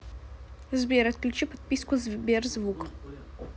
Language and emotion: Russian, neutral